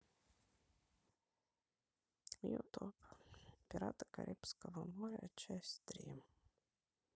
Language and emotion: Russian, sad